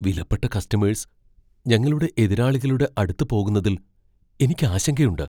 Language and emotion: Malayalam, fearful